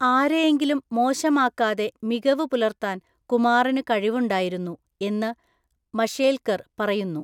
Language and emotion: Malayalam, neutral